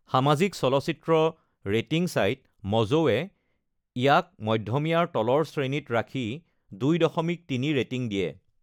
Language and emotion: Assamese, neutral